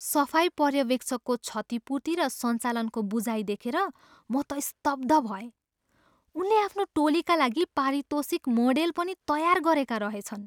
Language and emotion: Nepali, surprised